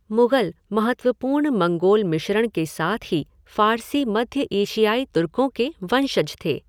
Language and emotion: Hindi, neutral